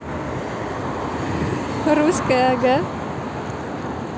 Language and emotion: Russian, positive